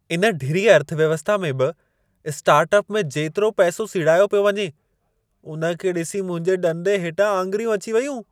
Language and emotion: Sindhi, surprised